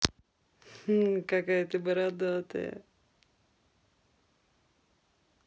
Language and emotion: Russian, positive